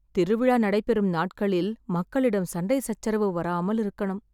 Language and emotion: Tamil, sad